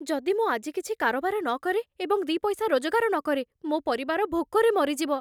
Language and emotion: Odia, fearful